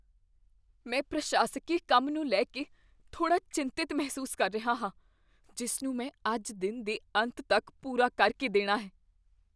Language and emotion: Punjabi, fearful